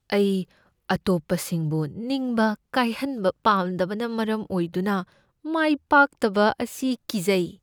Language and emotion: Manipuri, fearful